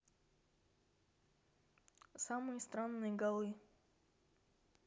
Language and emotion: Russian, neutral